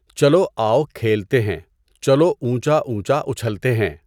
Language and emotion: Urdu, neutral